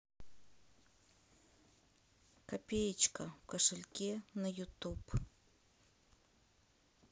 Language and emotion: Russian, neutral